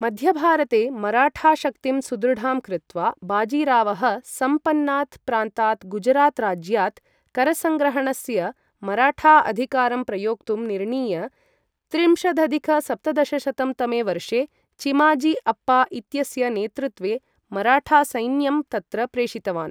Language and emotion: Sanskrit, neutral